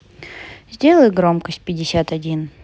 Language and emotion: Russian, neutral